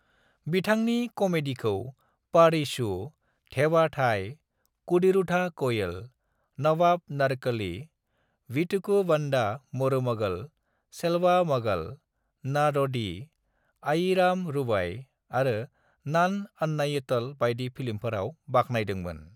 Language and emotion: Bodo, neutral